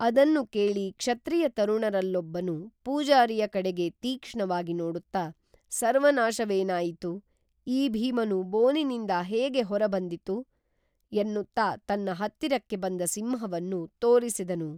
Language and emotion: Kannada, neutral